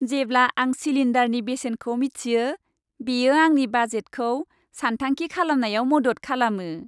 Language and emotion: Bodo, happy